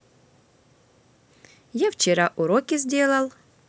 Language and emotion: Russian, positive